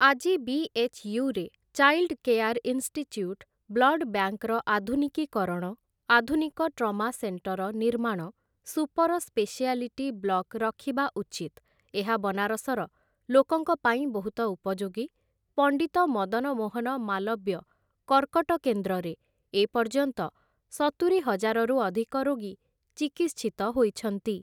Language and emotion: Odia, neutral